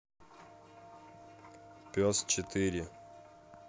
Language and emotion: Russian, neutral